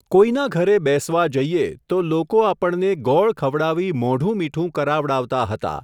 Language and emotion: Gujarati, neutral